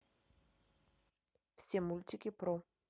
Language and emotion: Russian, neutral